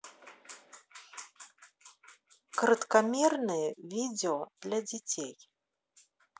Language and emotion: Russian, neutral